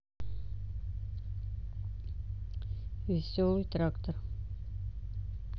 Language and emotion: Russian, neutral